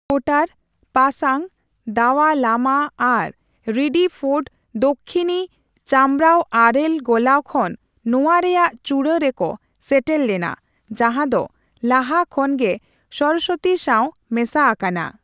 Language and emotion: Santali, neutral